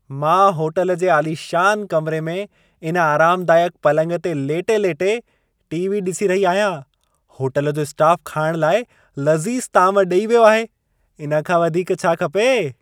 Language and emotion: Sindhi, happy